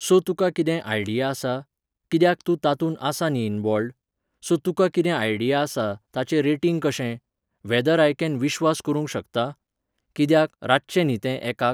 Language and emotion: Goan Konkani, neutral